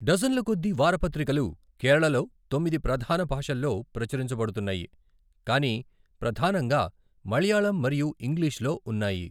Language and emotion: Telugu, neutral